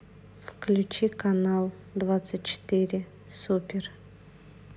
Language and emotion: Russian, neutral